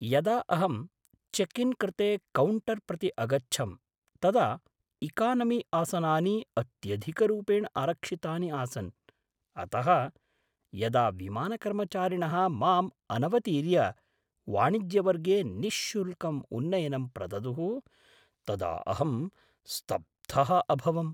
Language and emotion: Sanskrit, surprised